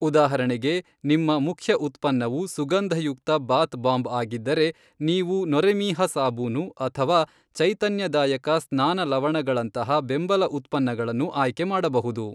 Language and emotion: Kannada, neutral